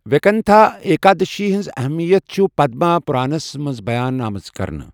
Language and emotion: Kashmiri, neutral